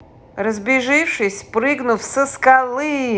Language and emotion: Russian, positive